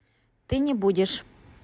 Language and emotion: Russian, neutral